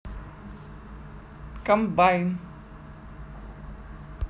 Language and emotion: Russian, neutral